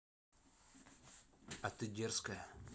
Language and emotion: Russian, neutral